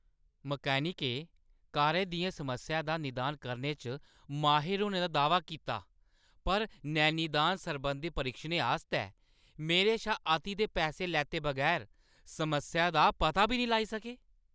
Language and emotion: Dogri, angry